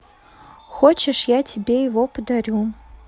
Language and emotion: Russian, neutral